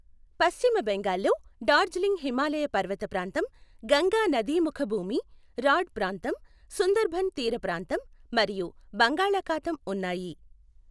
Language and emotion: Telugu, neutral